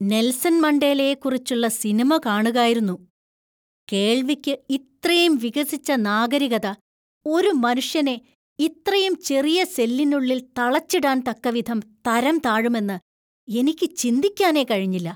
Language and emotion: Malayalam, disgusted